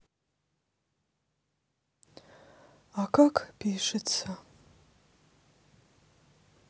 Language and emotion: Russian, sad